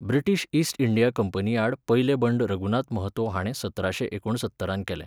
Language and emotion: Goan Konkani, neutral